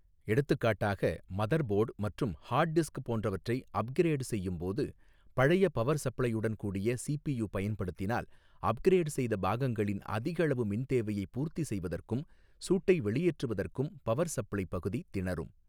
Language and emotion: Tamil, neutral